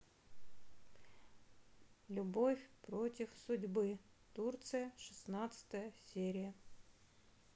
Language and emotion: Russian, neutral